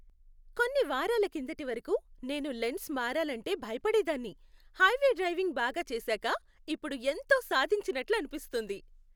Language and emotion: Telugu, happy